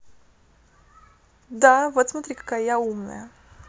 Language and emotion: Russian, positive